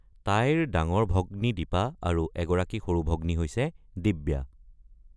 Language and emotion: Assamese, neutral